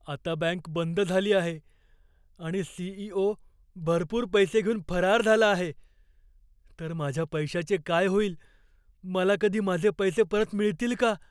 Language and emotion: Marathi, fearful